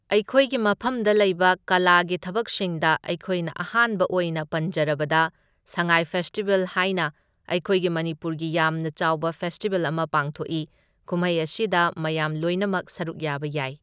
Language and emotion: Manipuri, neutral